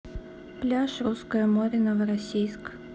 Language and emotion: Russian, neutral